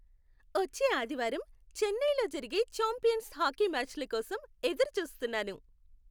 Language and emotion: Telugu, happy